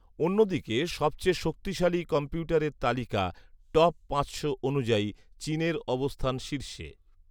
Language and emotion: Bengali, neutral